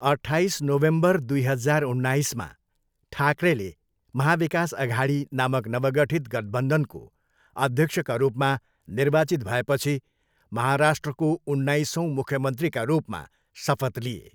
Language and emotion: Nepali, neutral